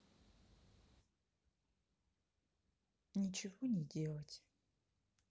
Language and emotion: Russian, sad